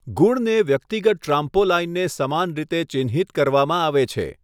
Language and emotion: Gujarati, neutral